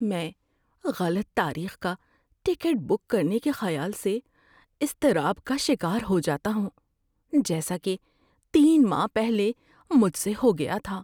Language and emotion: Urdu, fearful